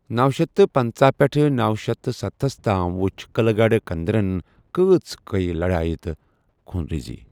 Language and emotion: Kashmiri, neutral